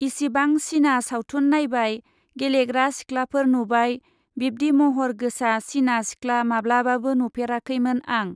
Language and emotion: Bodo, neutral